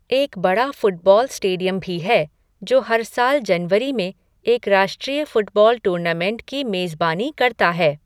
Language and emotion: Hindi, neutral